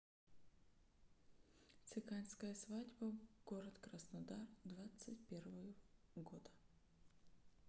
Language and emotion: Russian, neutral